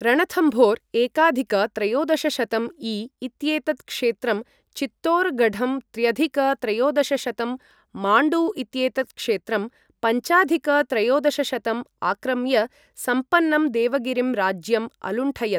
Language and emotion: Sanskrit, neutral